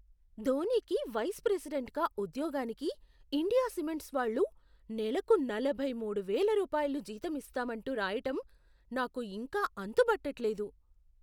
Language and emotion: Telugu, surprised